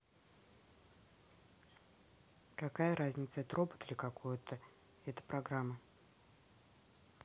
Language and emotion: Russian, neutral